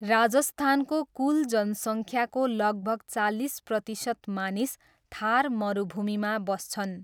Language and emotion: Nepali, neutral